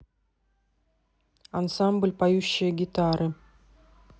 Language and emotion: Russian, neutral